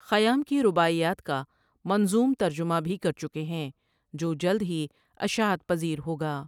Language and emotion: Urdu, neutral